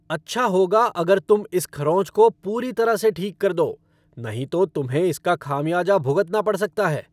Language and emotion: Hindi, angry